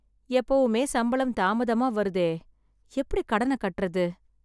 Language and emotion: Tamil, sad